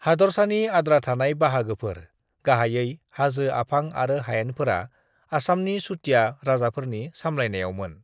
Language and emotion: Bodo, neutral